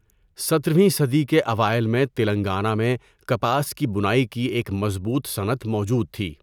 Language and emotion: Urdu, neutral